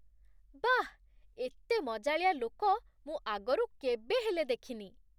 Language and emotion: Odia, surprised